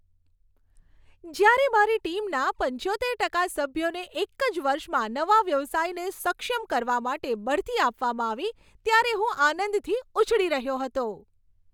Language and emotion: Gujarati, happy